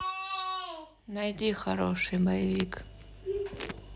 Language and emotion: Russian, neutral